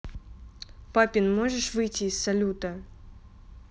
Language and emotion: Russian, neutral